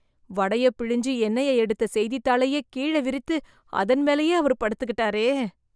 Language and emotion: Tamil, disgusted